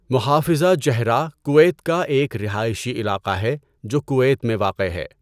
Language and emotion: Urdu, neutral